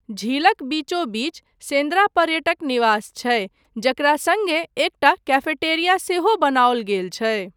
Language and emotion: Maithili, neutral